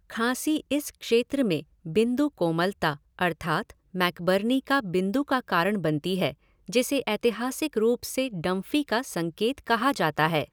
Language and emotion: Hindi, neutral